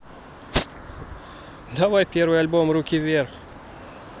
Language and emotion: Russian, positive